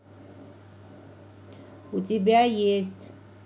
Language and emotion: Russian, neutral